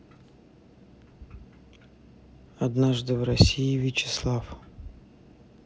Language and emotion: Russian, neutral